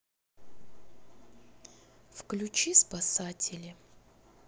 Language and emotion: Russian, neutral